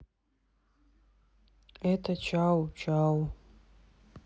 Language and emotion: Russian, sad